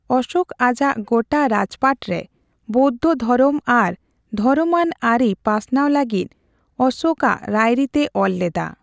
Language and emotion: Santali, neutral